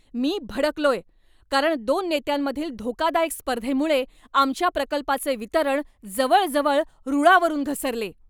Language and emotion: Marathi, angry